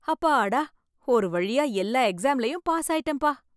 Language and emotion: Tamil, happy